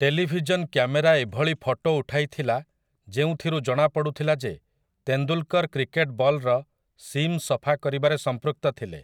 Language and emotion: Odia, neutral